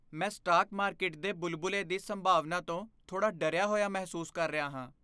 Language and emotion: Punjabi, fearful